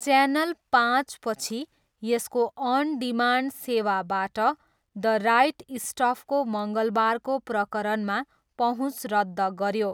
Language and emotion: Nepali, neutral